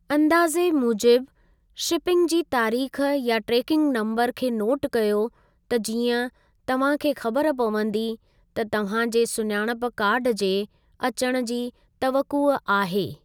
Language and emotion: Sindhi, neutral